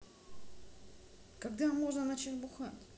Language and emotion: Russian, neutral